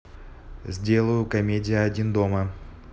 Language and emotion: Russian, neutral